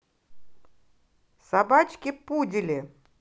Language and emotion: Russian, positive